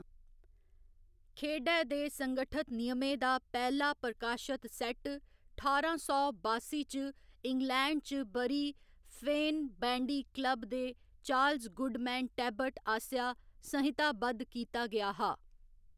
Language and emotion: Dogri, neutral